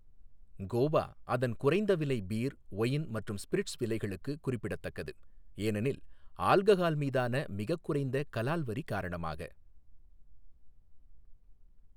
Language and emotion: Tamil, neutral